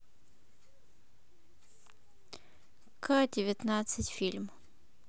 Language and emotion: Russian, neutral